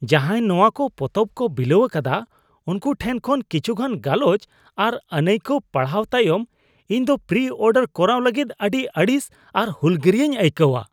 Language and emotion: Santali, disgusted